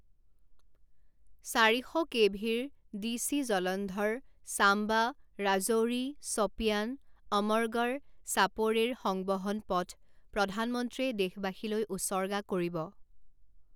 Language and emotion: Assamese, neutral